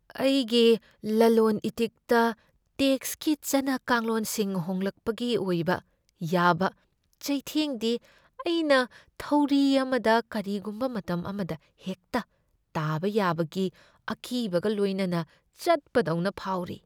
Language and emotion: Manipuri, fearful